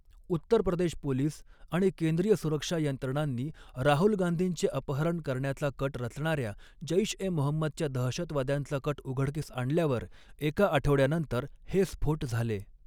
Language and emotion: Marathi, neutral